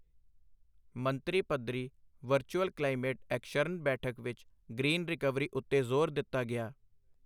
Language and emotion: Punjabi, neutral